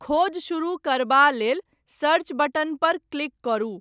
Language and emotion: Maithili, neutral